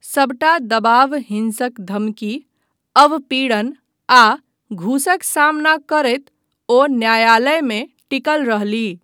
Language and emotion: Maithili, neutral